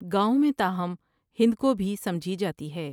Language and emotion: Urdu, neutral